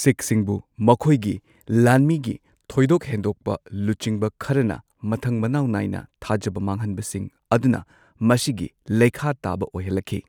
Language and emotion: Manipuri, neutral